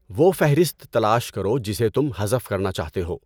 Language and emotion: Urdu, neutral